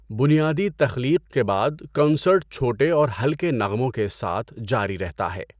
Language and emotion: Urdu, neutral